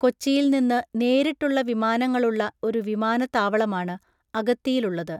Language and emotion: Malayalam, neutral